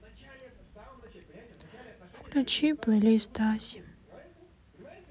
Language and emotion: Russian, sad